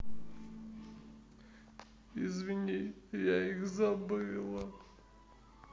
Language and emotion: Russian, sad